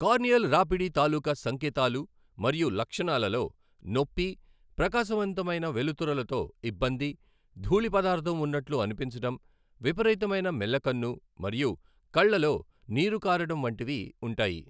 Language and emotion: Telugu, neutral